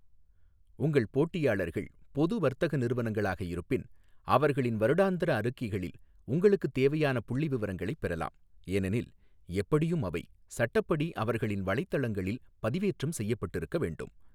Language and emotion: Tamil, neutral